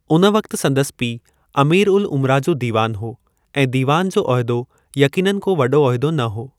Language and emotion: Sindhi, neutral